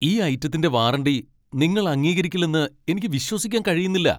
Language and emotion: Malayalam, angry